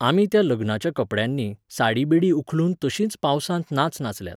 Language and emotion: Goan Konkani, neutral